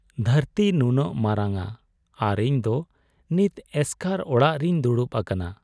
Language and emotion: Santali, sad